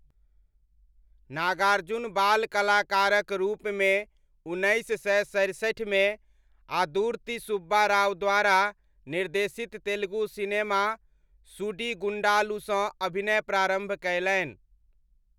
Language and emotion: Maithili, neutral